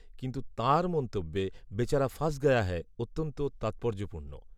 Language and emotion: Bengali, neutral